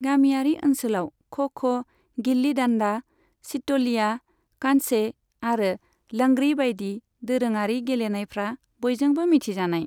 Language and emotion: Bodo, neutral